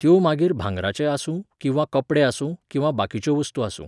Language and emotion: Goan Konkani, neutral